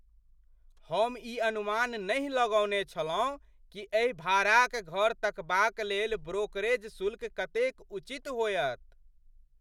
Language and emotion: Maithili, surprised